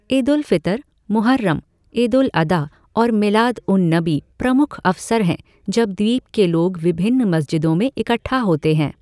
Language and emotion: Hindi, neutral